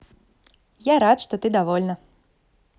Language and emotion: Russian, positive